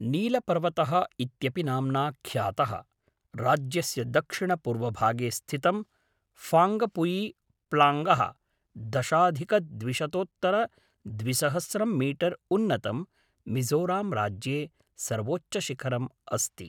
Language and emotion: Sanskrit, neutral